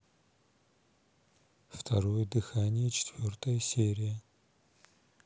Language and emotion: Russian, neutral